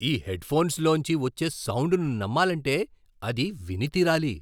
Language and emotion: Telugu, surprised